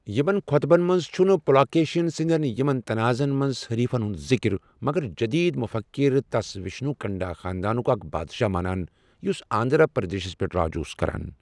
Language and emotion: Kashmiri, neutral